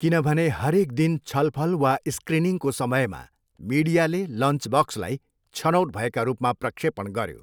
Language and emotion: Nepali, neutral